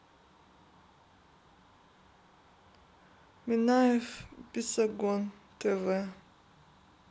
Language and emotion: Russian, sad